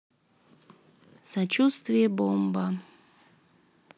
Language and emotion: Russian, sad